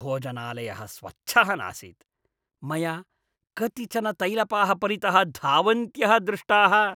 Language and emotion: Sanskrit, disgusted